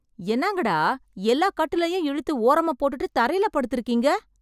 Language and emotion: Tamil, surprised